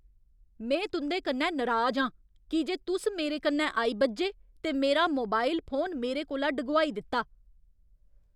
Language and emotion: Dogri, angry